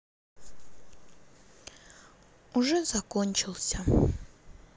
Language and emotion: Russian, sad